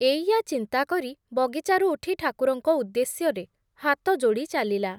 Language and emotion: Odia, neutral